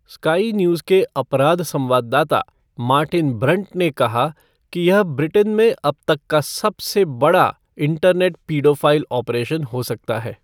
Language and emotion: Hindi, neutral